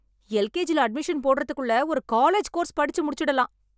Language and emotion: Tamil, angry